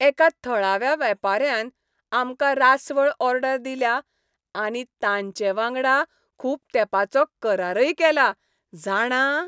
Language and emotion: Goan Konkani, happy